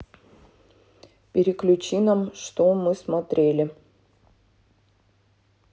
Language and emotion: Russian, neutral